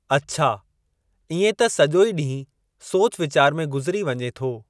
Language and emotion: Sindhi, neutral